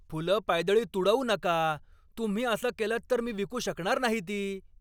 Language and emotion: Marathi, angry